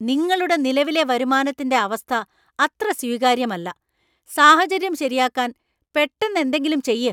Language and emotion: Malayalam, angry